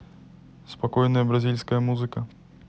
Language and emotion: Russian, neutral